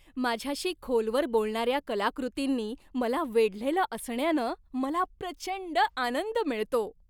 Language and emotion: Marathi, happy